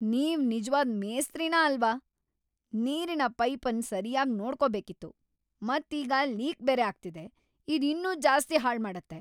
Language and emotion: Kannada, angry